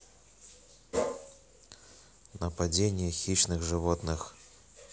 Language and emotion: Russian, neutral